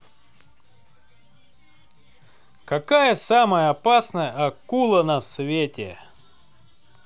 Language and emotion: Russian, positive